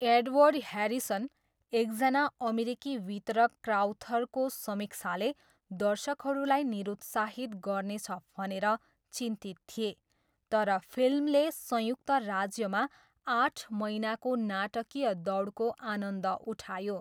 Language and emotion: Nepali, neutral